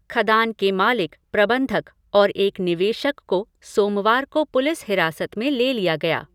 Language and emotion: Hindi, neutral